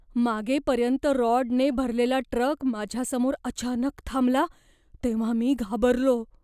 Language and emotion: Marathi, fearful